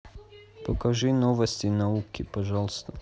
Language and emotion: Russian, neutral